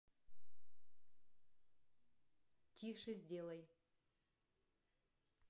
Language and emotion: Russian, neutral